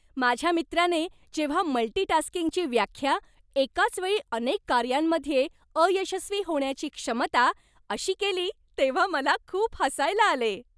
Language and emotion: Marathi, happy